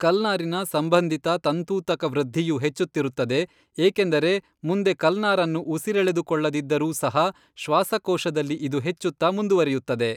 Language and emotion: Kannada, neutral